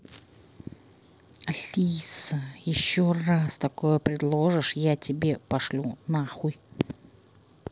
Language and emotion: Russian, angry